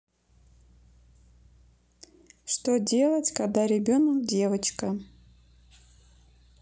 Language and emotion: Russian, neutral